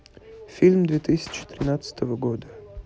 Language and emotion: Russian, neutral